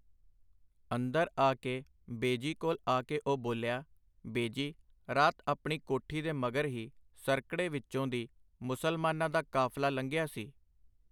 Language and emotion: Punjabi, neutral